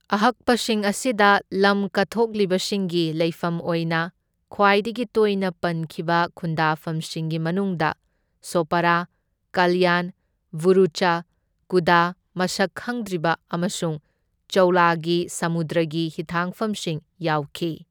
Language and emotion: Manipuri, neutral